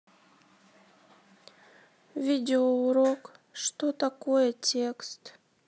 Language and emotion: Russian, sad